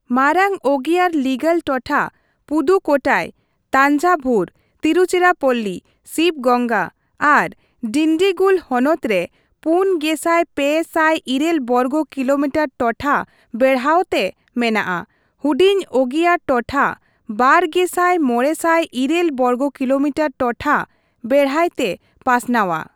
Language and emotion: Santali, neutral